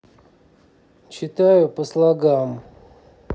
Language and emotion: Russian, neutral